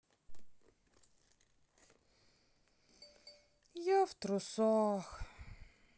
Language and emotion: Russian, sad